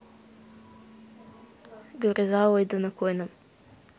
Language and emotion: Russian, neutral